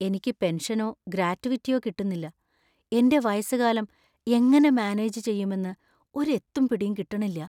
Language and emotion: Malayalam, fearful